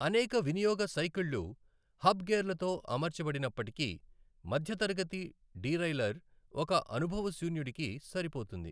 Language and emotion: Telugu, neutral